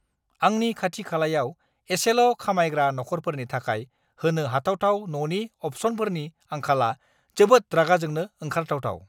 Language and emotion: Bodo, angry